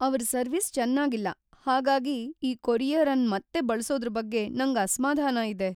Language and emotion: Kannada, fearful